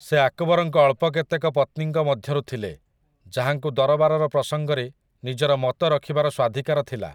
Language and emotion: Odia, neutral